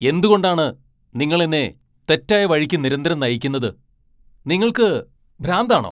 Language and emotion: Malayalam, angry